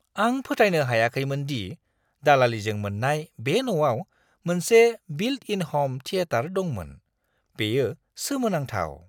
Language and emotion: Bodo, surprised